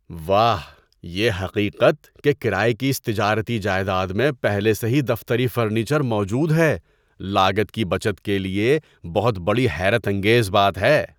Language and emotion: Urdu, surprised